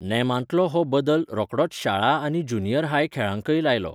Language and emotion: Goan Konkani, neutral